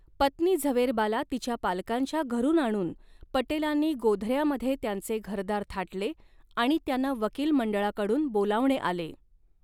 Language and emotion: Marathi, neutral